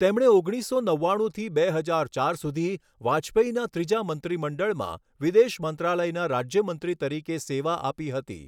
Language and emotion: Gujarati, neutral